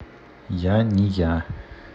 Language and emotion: Russian, neutral